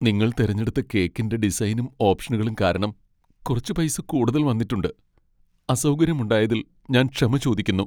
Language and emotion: Malayalam, sad